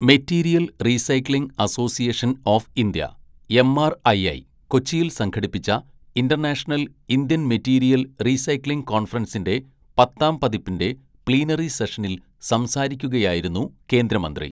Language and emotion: Malayalam, neutral